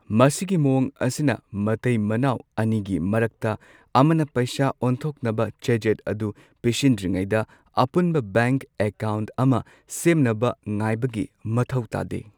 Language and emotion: Manipuri, neutral